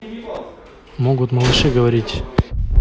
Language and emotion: Russian, neutral